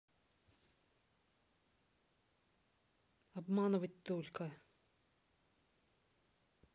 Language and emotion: Russian, neutral